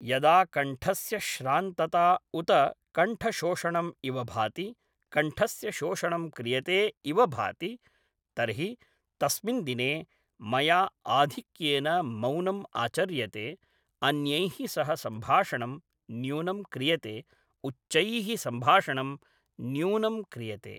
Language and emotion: Sanskrit, neutral